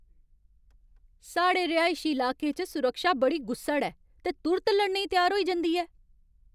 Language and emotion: Dogri, angry